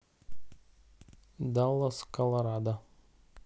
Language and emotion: Russian, neutral